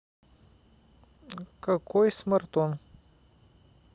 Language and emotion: Russian, neutral